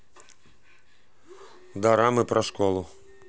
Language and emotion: Russian, neutral